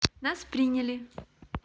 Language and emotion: Russian, positive